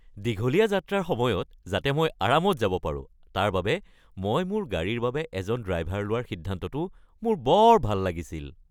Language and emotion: Assamese, happy